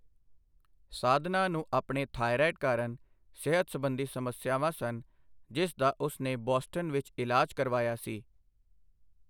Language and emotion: Punjabi, neutral